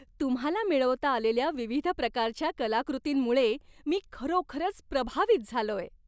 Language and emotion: Marathi, happy